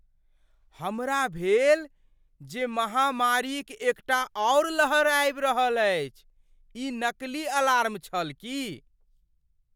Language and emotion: Maithili, surprised